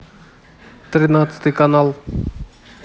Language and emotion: Russian, neutral